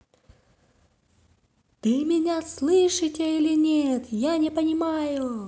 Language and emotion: Russian, positive